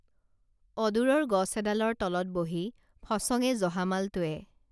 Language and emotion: Assamese, neutral